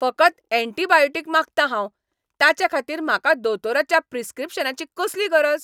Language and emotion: Goan Konkani, angry